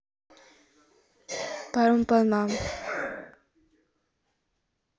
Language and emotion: Russian, neutral